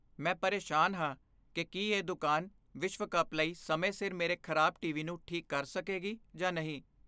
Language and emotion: Punjabi, fearful